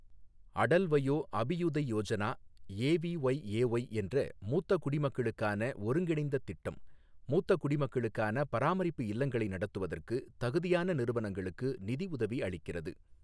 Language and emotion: Tamil, neutral